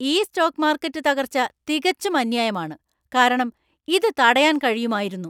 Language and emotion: Malayalam, angry